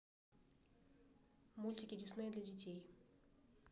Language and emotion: Russian, neutral